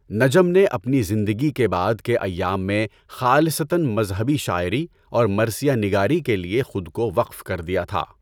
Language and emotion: Urdu, neutral